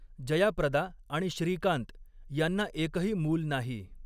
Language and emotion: Marathi, neutral